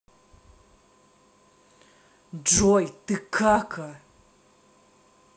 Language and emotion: Russian, angry